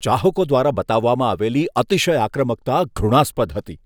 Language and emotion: Gujarati, disgusted